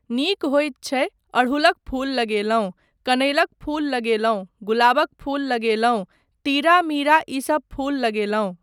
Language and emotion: Maithili, neutral